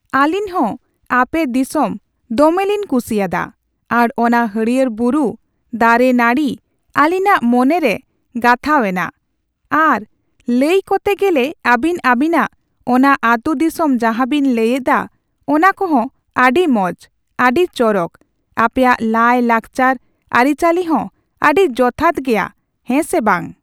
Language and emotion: Santali, neutral